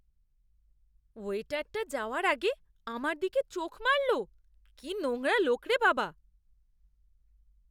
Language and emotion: Bengali, disgusted